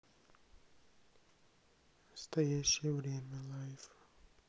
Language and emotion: Russian, neutral